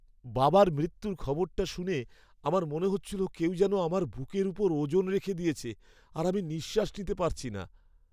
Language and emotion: Bengali, sad